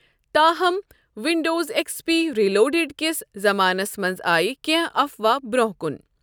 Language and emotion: Kashmiri, neutral